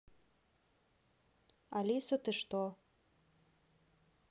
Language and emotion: Russian, neutral